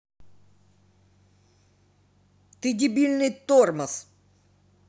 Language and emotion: Russian, angry